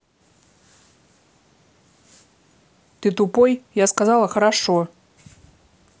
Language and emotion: Russian, angry